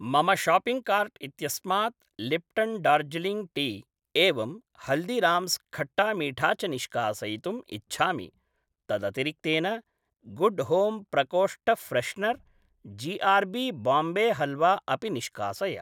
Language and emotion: Sanskrit, neutral